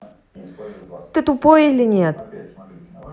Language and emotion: Russian, angry